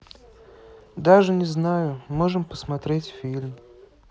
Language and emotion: Russian, sad